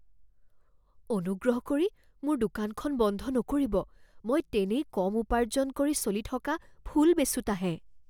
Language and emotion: Assamese, fearful